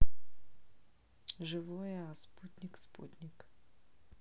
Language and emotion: Russian, neutral